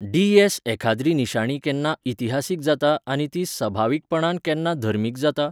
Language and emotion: Goan Konkani, neutral